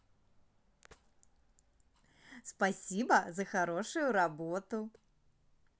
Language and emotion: Russian, positive